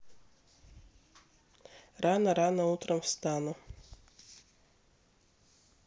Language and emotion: Russian, neutral